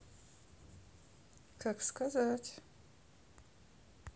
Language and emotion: Russian, neutral